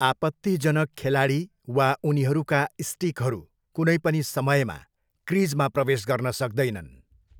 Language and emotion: Nepali, neutral